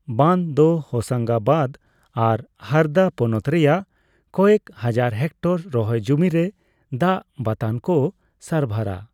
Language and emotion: Santali, neutral